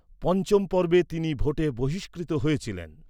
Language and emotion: Bengali, neutral